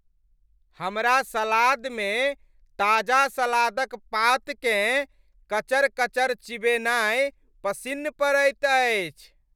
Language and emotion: Maithili, happy